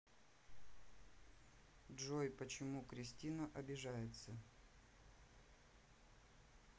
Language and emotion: Russian, neutral